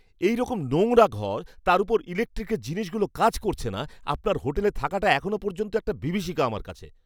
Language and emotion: Bengali, angry